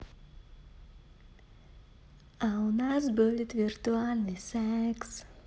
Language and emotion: Russian, positive